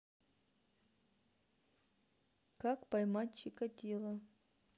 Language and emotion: Russian, neutral